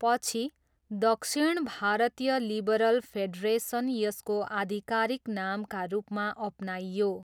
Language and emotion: Nepali, neutral